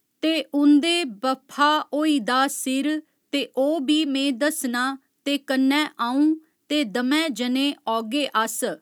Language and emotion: Dogri, neutral